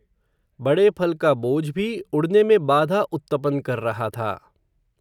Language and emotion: Hindi, neutral